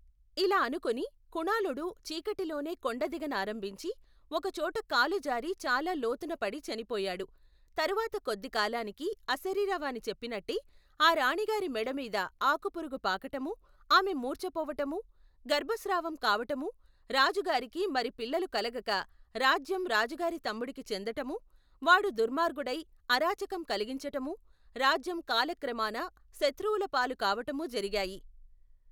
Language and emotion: Telugu, neutral